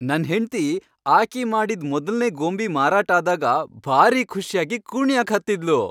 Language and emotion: Kannada, happy